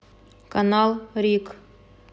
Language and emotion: Russian, neutral